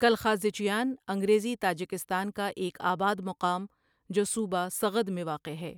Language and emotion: Urdu, neutral